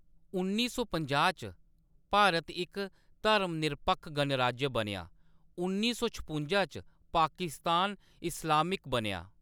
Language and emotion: Dogri, neutral